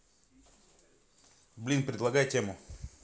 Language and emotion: Russian, neutral